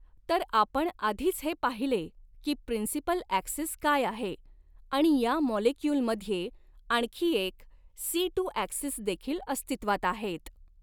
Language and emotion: Marathi, neutral